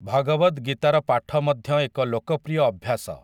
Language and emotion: Odia, neutral